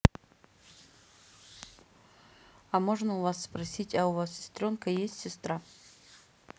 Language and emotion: Russian, neutral